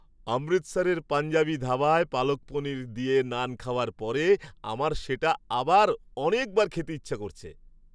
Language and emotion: Bengali, happy